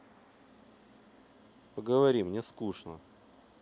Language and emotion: Russian, neutral